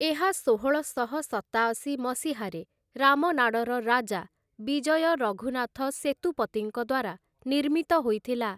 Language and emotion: Odia, neutral